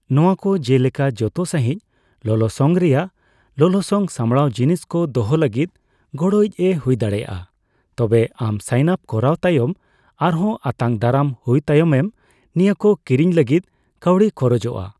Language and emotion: Santali, neutral